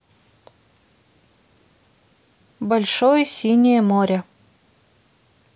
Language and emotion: Russian, neutral